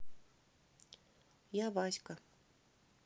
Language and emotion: Russian, neutral